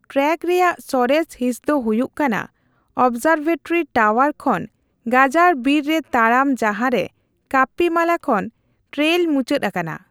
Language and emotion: Santali, neutral